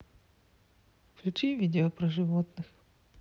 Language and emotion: Russian, neutral